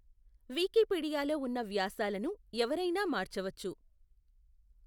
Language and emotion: Telugu, neutral